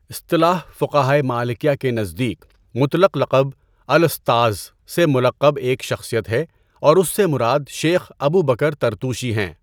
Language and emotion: Urdu, neutral